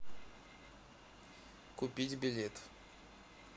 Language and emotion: Russian, neutral